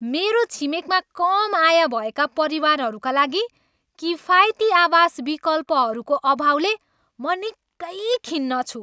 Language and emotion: Nepali, angry